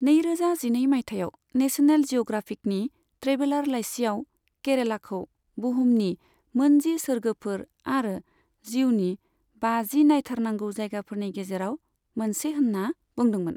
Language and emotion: Bodo, neutral